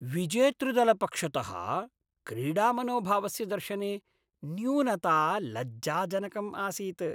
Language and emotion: Sanskrit, disgusted